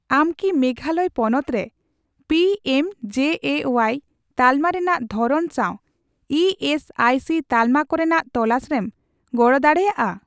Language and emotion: Santali, neutral